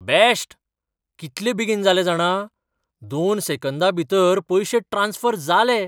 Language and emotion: Goan Konkani, surprised